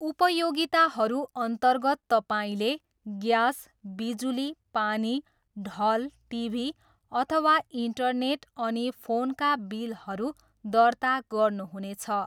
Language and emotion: Nepali, neutral